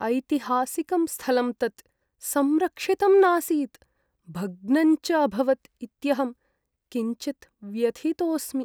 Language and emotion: Sanskrit, sad